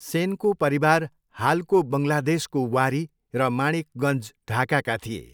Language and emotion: Nepali, neutral